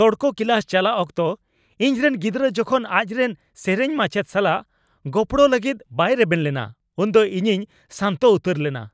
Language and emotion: Santali, angry